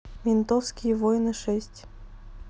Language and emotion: Russian, neutral